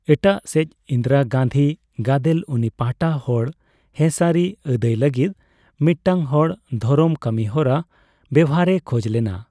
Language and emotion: Santali, neutral